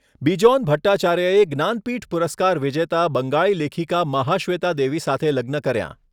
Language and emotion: Gujarati, neutral